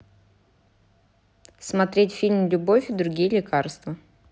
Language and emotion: Russian, neutral